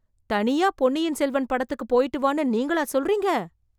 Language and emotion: Tamil, surprised